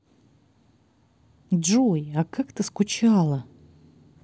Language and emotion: Russian, positive